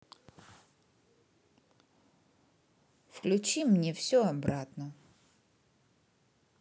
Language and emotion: Russian, neutral